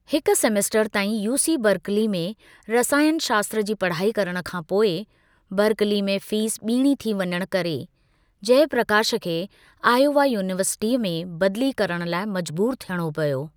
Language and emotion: Sindhi, neutral